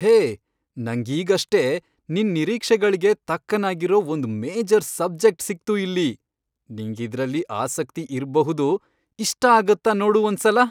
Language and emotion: Kannada, happy